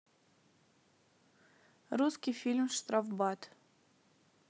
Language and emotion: Russian, neutral